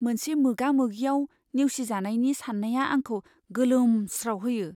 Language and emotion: Bodo, fearful